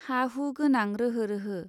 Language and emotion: Bodo, neutral